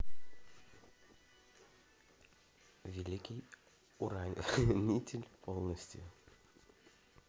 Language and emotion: Russian, positive